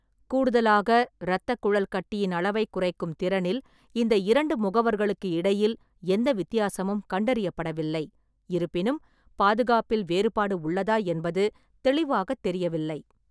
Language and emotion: Tamil, neutral